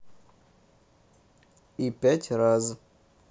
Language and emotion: Russian, neutral